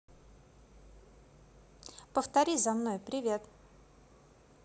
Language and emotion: Russian, neutral